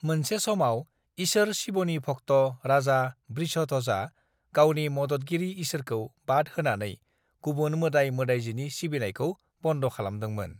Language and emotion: Bodo, neutral